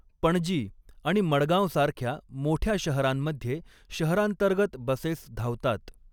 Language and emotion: Marathi, neutral